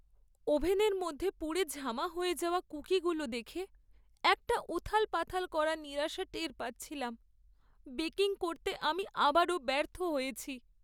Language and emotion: Bengali, sad